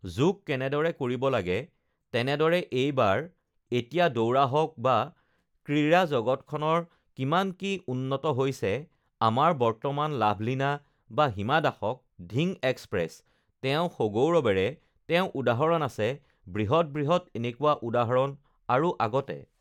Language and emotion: Assamese, neutral